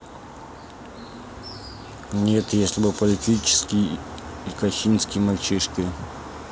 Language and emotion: Russian, neutral